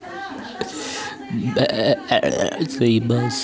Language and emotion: Russian, neutral